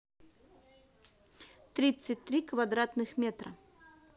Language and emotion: Russian, neutral